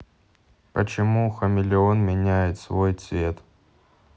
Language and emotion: Russian, neutral